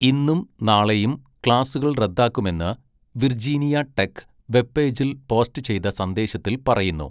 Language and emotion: Malayalam, neutral